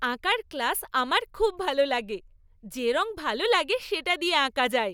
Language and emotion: Bengali, happy